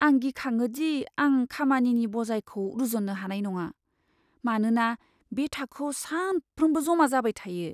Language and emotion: Bodo, fearful